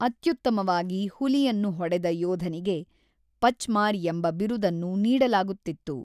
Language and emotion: Kannada, neutral